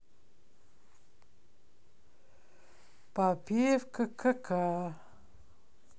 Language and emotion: Russian, positive